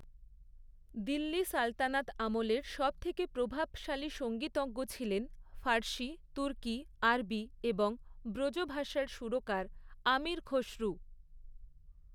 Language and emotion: Bengali, neutral